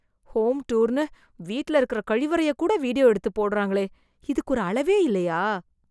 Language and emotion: Tamil, disgusted